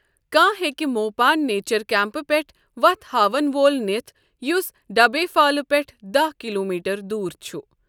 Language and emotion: Kashmiri, neutral